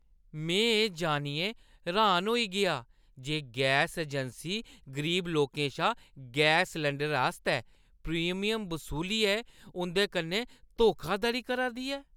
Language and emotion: Dogri, disgusted